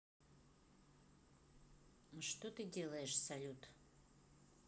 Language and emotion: Russian, neutral